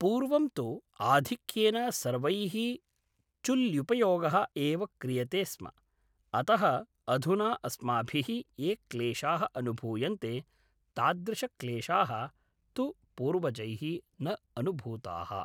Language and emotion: Sanskrit, neutral